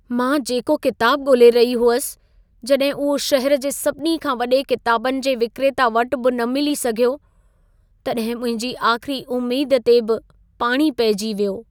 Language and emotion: Sindhi, sad